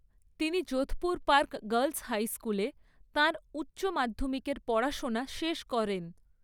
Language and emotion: Bengali, neutral